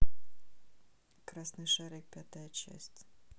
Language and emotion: Russian, neutral